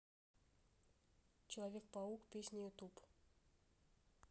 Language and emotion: Russian, neutral